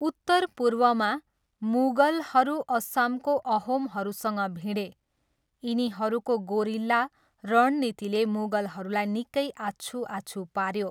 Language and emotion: Nepali, neutral